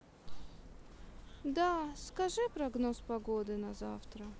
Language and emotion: Russian, sad